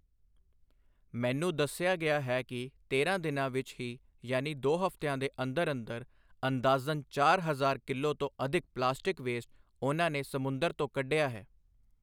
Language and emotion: Punjabi, neutral